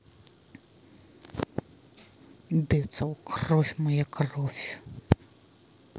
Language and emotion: Russian, angry